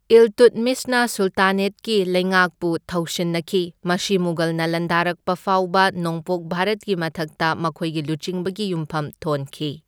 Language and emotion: Manipuri, neutral